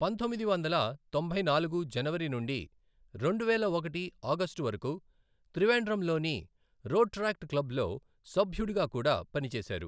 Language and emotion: Telugu, neutral